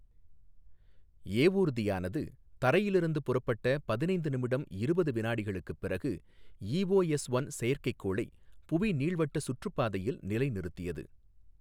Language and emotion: Tamil, neutral